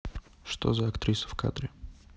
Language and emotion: Russian, neutral